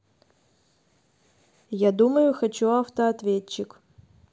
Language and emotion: Russian, neutral